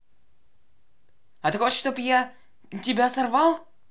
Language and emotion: Russian, angry